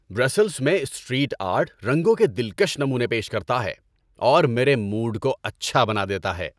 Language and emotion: Urdu, happy